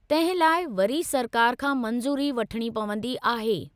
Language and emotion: Sindhi, neutral